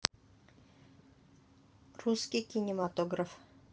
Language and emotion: Russian, neutral